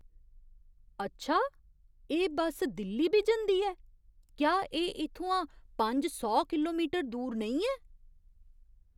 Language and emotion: Dogri, surprised